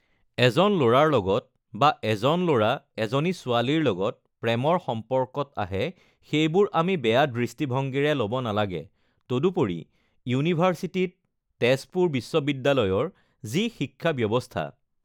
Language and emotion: Assamese, neutral